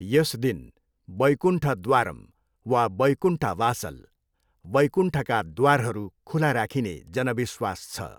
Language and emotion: Nepali, neutral